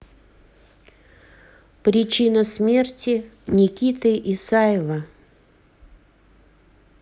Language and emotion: Russian, neutral